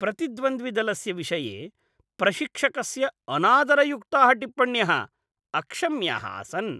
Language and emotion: Sanskrit, disgusted